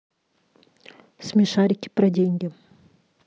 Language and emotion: Russian, neutral